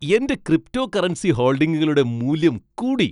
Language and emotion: Malayalam, happy